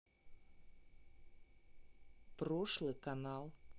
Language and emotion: Russian, neutral